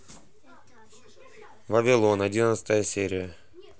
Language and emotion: Russian, neutral